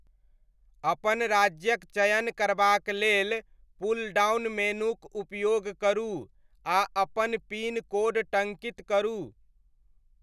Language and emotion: Maithili, neutral